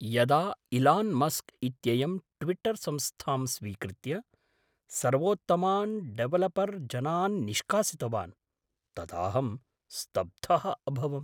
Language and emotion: Sanskrit, surprised